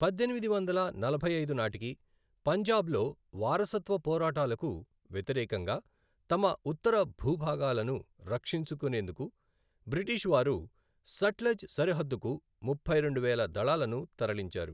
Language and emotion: Telugu, neutral